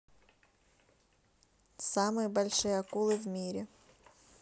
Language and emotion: Russian, neutral